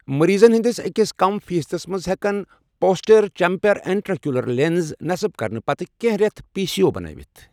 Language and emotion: Kashmiri, neutral